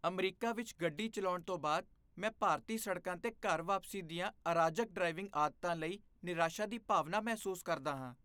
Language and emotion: Punjabi, disgusted